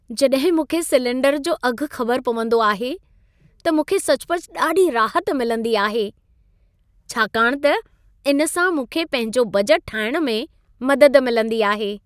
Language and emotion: Sindhi, happy